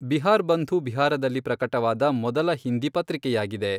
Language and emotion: Kannada, neutral